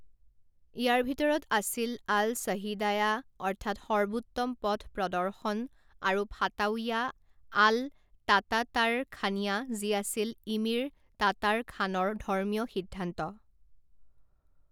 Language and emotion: Assamese, neutral